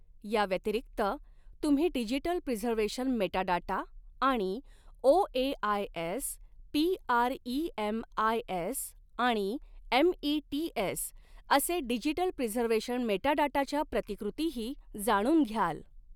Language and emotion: Marathi, neutral